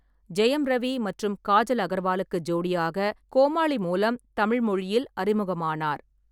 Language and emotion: Tamil, neutral